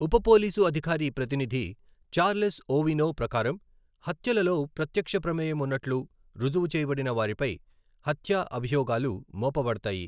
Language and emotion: Telugu, neutral